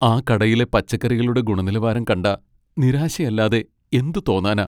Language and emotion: Malayalam, sad